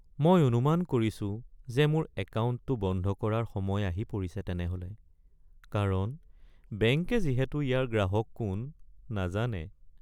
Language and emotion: Assamese, sad